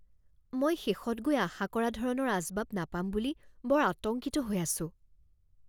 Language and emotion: Assamese, fearful